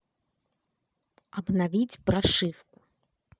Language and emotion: Russian, angry